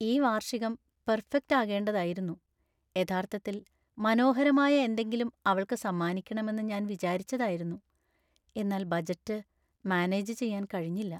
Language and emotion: Malayalam, sad